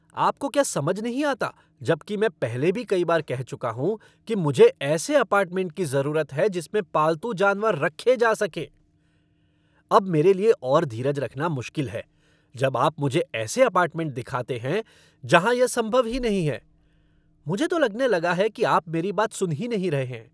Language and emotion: Hindi, angry